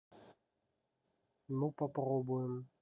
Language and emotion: Russian, neutral